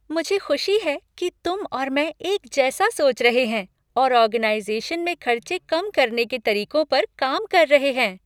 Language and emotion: Hindi, happy